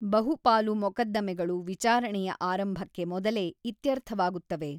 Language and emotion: Kannada, neutral